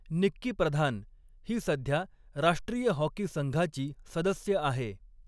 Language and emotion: Marathi, neutral